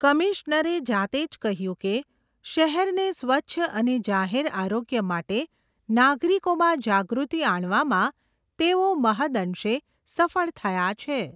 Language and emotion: Gujarati, neutral